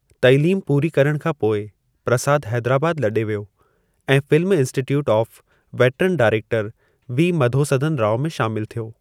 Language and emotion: Sindhi, neutral